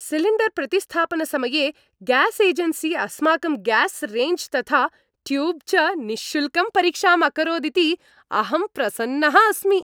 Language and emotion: Sanskrit, happy